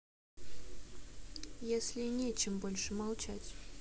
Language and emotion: Russian, sad